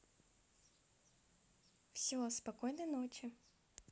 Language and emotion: Russian, positive